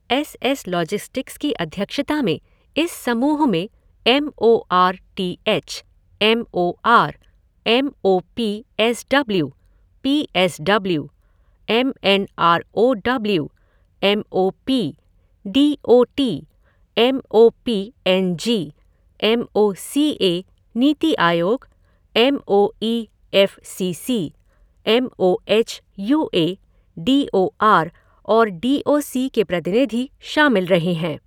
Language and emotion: Hindi, neutral